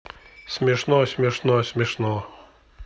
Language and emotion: Russian, neutral